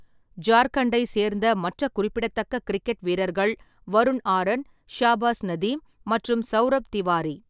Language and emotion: Tamil, neutral